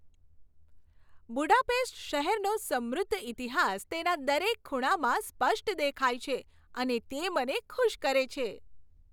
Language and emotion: Gujarati, happy